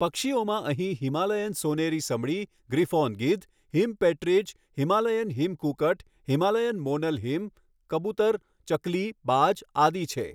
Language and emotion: Gujarati, neutral